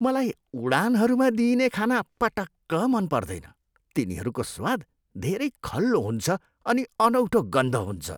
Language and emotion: Nepali, disgusted